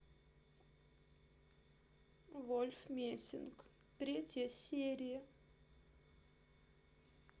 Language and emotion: Russian, sad